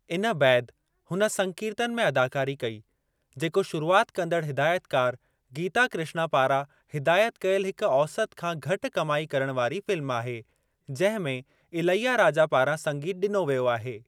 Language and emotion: Sindhi, neutral